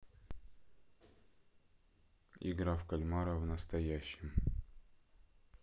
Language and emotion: Russian, neutral